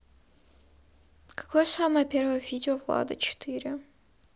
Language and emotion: Russian, sad